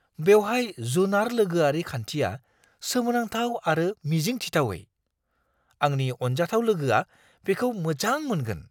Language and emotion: Bodo, surprised